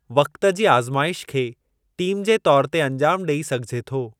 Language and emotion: Sindhi, neutral